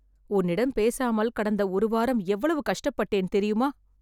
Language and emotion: Tamil, sad